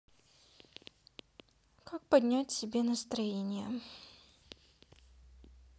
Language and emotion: Russian, sad